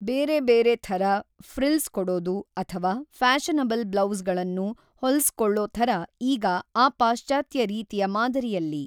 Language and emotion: Kannada, neutral